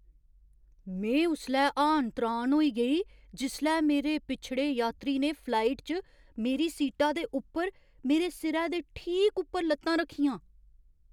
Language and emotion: Dogri, surprised